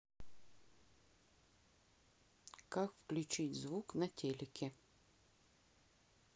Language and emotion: Russian, neutral